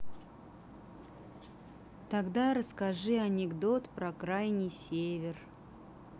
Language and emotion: Russian, neutral